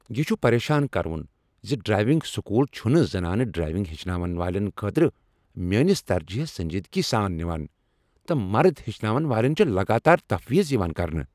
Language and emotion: Kashmiri, angry